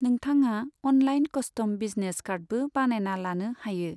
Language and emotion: Bodo, neutral